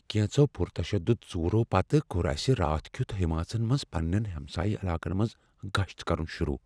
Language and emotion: Kashmiri, fearful